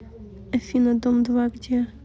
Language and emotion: Russian, neutral